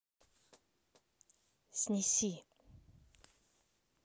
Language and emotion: Russian, neutral